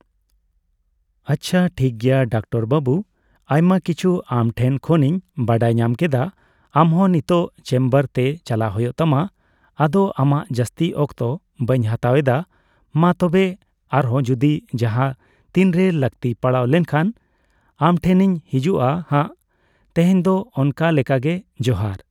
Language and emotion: Santali, neutral